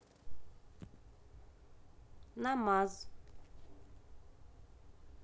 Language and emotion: Russian, neutral